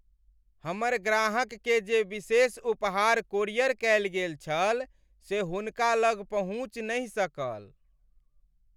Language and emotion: Maithili, sad